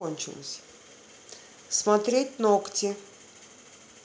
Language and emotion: Russian, neutral